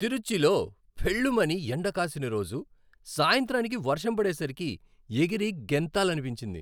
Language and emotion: Telugu, happy